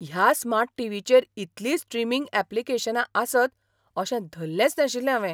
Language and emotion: Goan Konkani, surprised